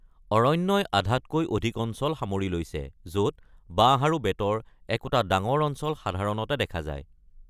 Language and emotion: Assamese, neutral